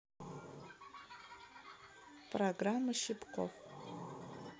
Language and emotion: Russian, neutral